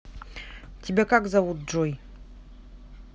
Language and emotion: Russian, neutral